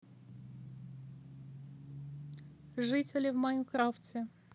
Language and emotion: Russian, neutral